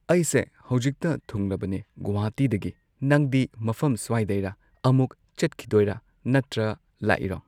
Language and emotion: Manipuri, neutral